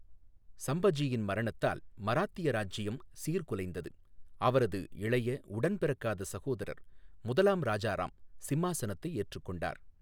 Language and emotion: Tamil, neutral